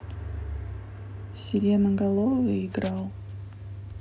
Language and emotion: Russian, neutral